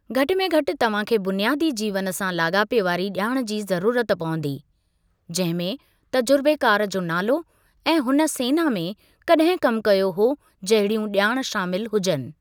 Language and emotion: Sindhi, neutral